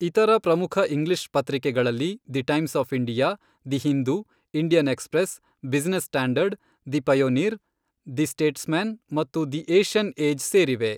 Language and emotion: Kannada, neutral